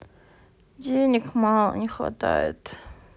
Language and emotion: Russian, sad